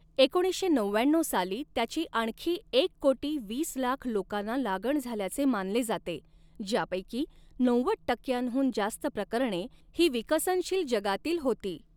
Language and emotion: Marathi, neutral